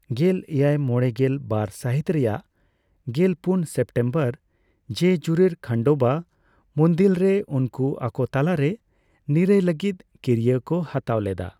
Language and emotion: Santali, neutral